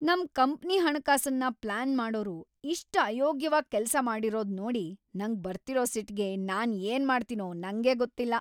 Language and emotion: Kannada, angry